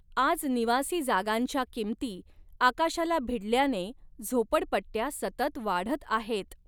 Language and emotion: Marathi, neutral